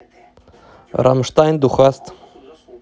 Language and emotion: Russian, neutral